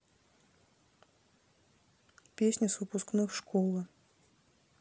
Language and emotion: Russian, neutral